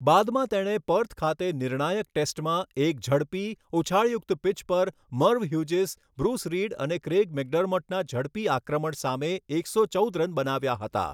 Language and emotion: Gujarati, neutral